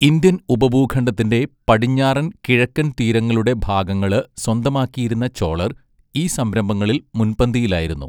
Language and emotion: Malayalam, neutral